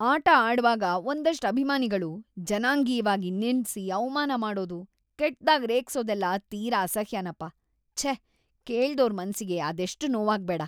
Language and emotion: Kannada, disgusted